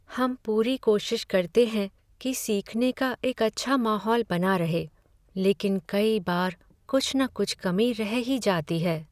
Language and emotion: Hindi, sad